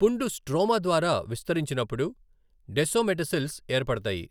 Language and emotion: Telugu, neutral